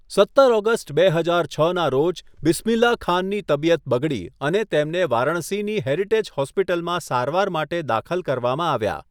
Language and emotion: Gujarati, neutral